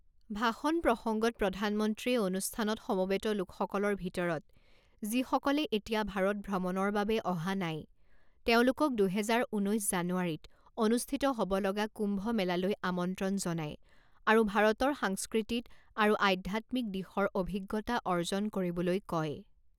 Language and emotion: Assamese, neutral